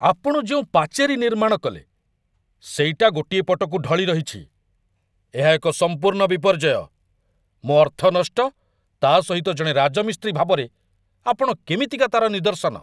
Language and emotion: Odia, angry